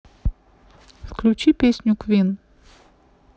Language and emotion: Russian, neutral